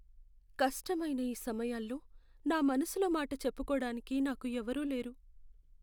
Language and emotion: Telugu, sad